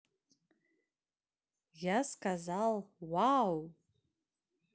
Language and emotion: Russian, positive